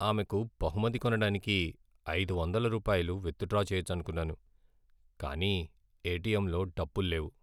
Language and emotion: Telugu, sad